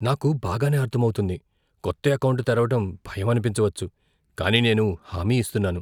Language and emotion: Telugu, fearful